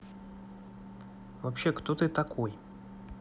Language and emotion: Russian, neutral